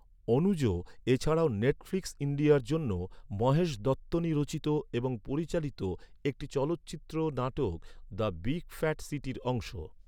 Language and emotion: Bengali, neutral